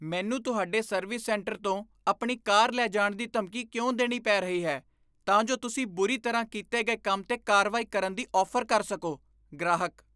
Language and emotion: Punjabi, disgusted